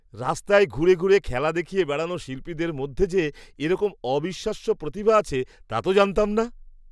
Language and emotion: Bengali, surprised